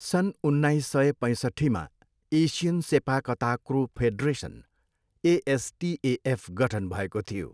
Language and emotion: Nepali, neutral